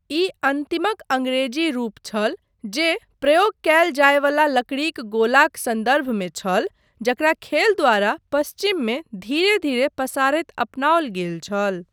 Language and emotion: Maithili, neutral